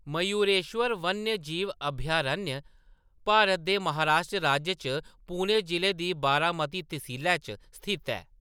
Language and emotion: Dogri, neutral